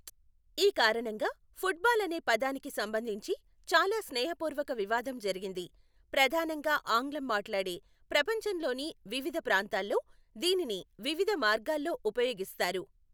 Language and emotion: Telugu, neutral